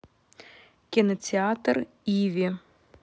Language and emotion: Russian, neutral